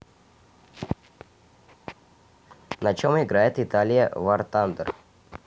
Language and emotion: Russian, neutral